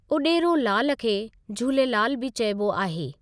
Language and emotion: Sindhi, neutral